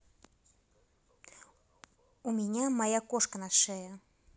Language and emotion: Russian, neutral